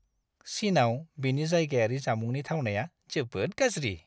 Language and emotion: Bodo, disgusted